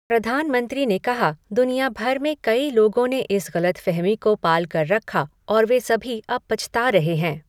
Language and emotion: Hindi, neutral